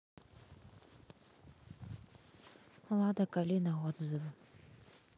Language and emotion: Russian, neutral